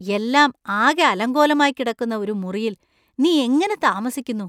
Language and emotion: Malayalam, disgusted